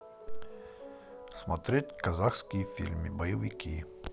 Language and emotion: Russian, neutral